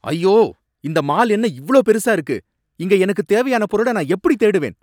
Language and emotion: Tamil, angry